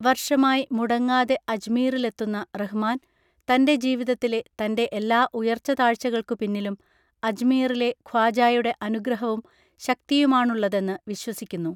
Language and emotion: Malayalam, neutral